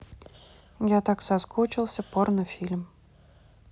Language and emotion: Russian, neutral